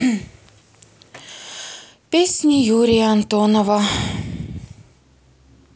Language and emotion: Russian, sad